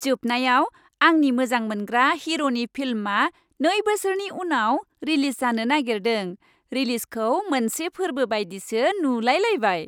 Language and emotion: Bodo, happy